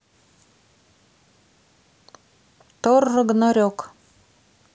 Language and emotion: Russian, neutral